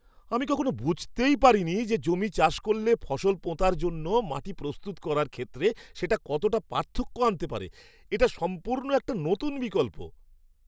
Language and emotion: Bengali, surprised